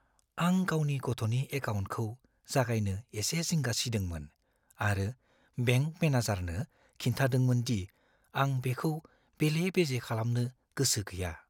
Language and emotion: Bodo, fearful